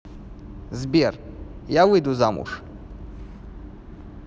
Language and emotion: Russian, neutral